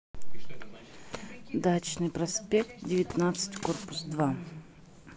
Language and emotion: Russian, neutral